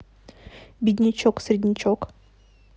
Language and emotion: Russian, neutral